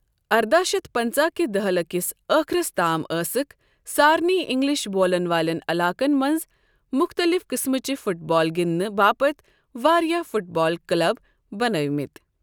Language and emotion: Kashmiri, neutral